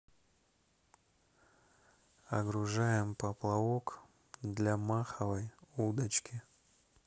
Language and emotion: Russian, neutral